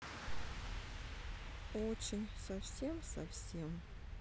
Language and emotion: Russian, sad